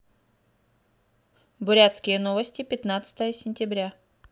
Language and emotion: Russian, neutral